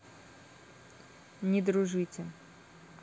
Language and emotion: Russian, neutral